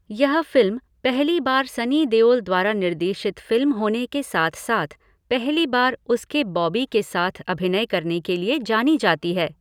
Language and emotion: Hindi, neutral